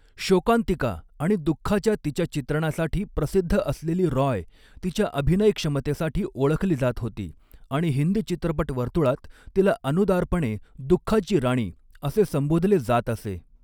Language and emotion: Marathi, neutral